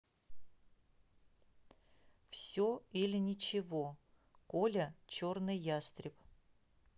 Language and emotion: Russian, neutral